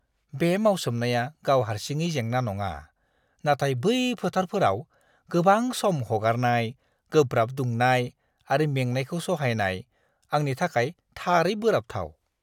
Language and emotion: Bodo, disgusted